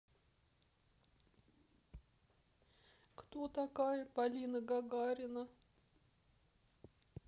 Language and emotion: Russian, sad